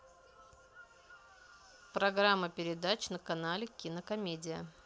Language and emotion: Russian, neutral